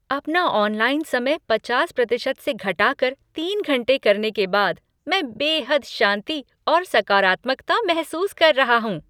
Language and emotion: Hindi, happy